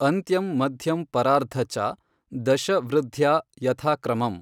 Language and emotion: Kannada, neutral